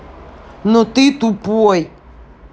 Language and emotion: Russian, angry